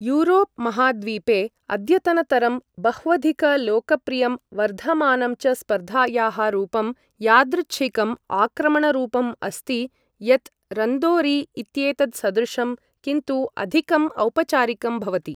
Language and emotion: Sanskrit, neutral